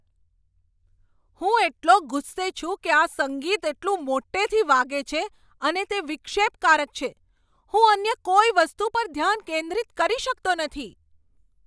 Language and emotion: Gujarati, angry